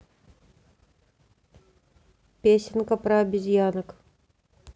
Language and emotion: Russian, neutral